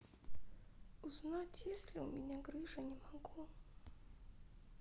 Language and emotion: Russian, sad